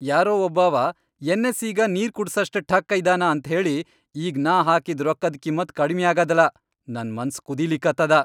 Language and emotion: Kannada, angry